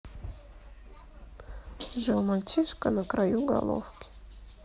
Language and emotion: Russian, sad